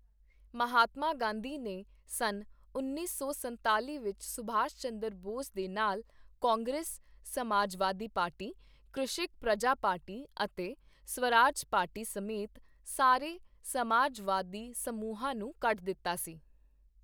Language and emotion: Punjabi, neutral